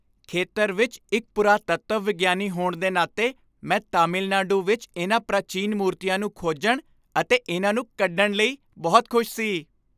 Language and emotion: Punjabi, happy